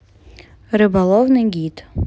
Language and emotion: Russian, neutral